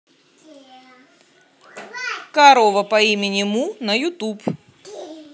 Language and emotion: Russian, positive